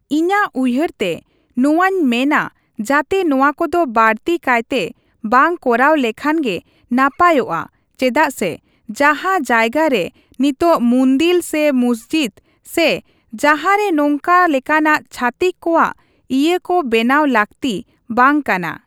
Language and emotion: Santali, neutral